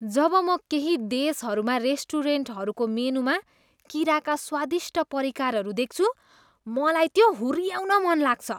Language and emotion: Nepali, disgusted